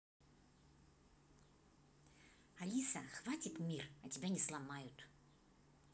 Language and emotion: Russian, angry